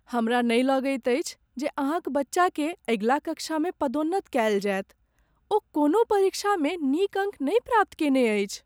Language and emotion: Maithili, sad